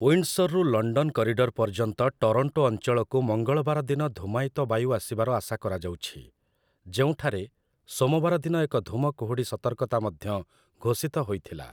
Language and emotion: Odia, neutral